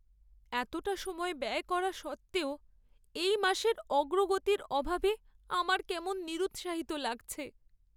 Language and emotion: Bengali, sad